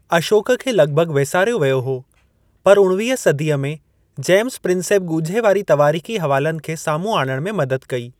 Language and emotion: Sindhi, neutral